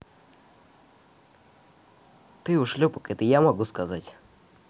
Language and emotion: Russian, angry